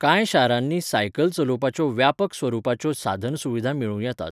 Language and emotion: Goan Konkani, neutral